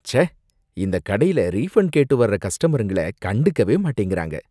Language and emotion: Tamil, disgusted